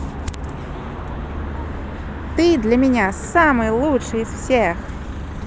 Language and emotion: Russian, positive